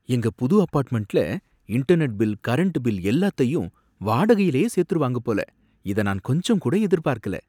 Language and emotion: Tamil, surprised